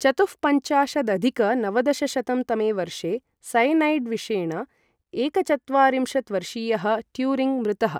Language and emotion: Sanskrit, neutral